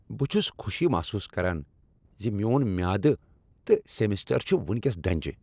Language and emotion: Kashmiri, happy